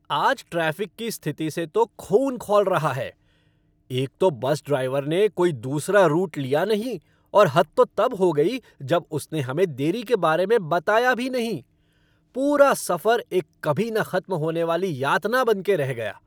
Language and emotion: Hindi, angry